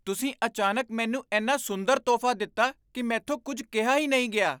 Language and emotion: Punjabi, surprised